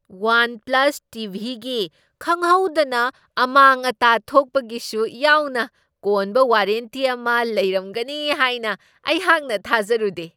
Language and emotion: Manipuri, surprised